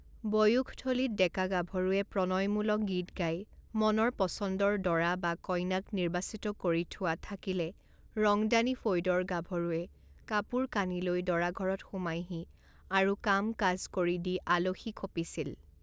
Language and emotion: Assamese, neutral